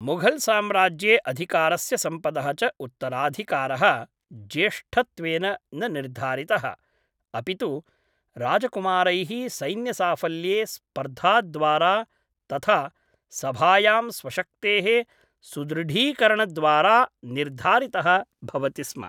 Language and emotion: Sanskrit, neutral